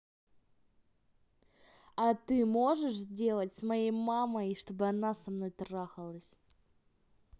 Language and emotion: Russian, neutral